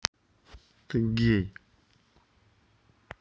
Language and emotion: Russian, neutral